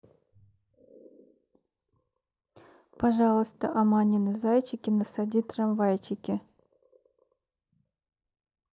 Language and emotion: Russian, neutral